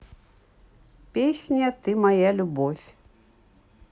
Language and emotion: Russian, neutral